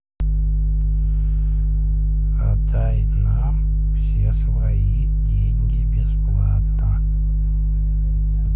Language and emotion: Russian, neutral